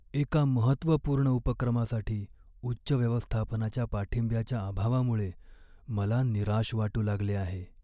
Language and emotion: Marathi, sad